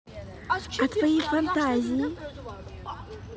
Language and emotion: Russian, positive